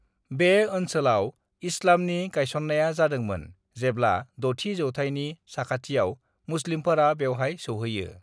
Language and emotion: Bodo, neutral